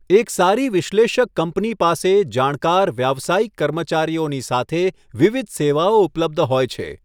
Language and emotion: Gujarati, neutral